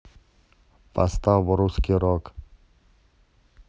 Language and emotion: Russian, neutral